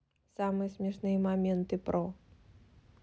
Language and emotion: Russian, neutral